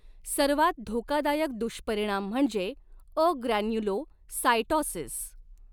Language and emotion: Marathi, neutral